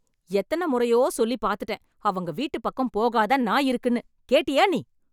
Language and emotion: Tamil, angry